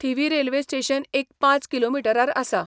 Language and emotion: Goan Konkani, neutral